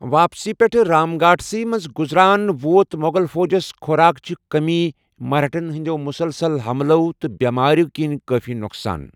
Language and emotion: Kashmiri, neutral